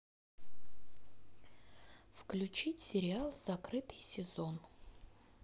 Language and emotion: Russian, sad